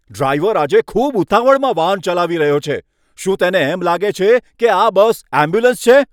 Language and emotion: Gujarati, angry